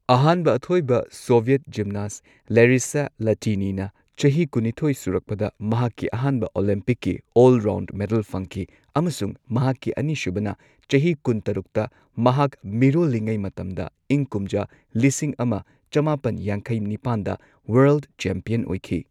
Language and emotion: Manipuri, neutral